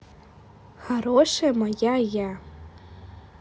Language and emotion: Russian, positive